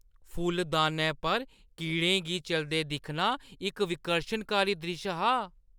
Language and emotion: Dogri, disgusted